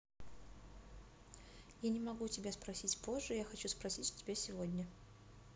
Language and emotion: Russian, neutral